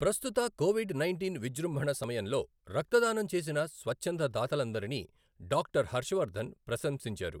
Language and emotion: Telugu, neutral